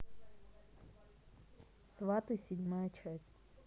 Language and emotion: Russian, neutral